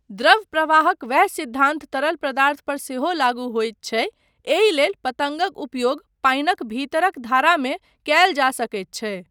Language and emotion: Maithili, neutral